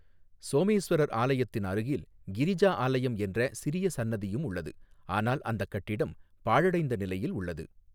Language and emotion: Tamil, neutral